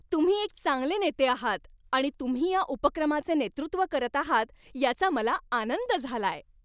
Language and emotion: Marathi, happy